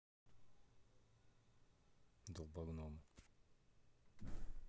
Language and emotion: Russian, neutral